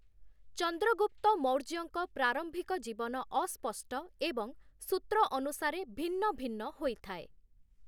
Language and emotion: Odia, neutral